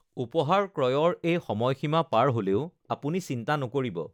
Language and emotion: Assamese, neutral